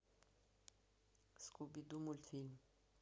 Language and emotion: Russian, neutral